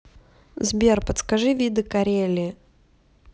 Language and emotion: Russian, neutral